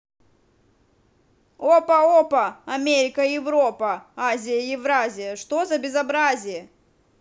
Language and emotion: Russian, angry